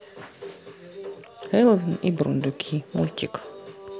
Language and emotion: Russian, neutral